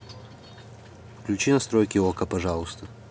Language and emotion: Russian, neutral